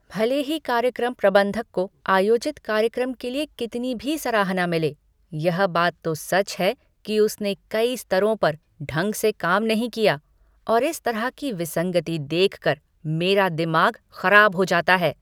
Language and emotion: Hindi, angry